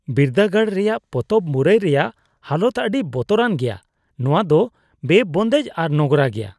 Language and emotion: Santali, disgusted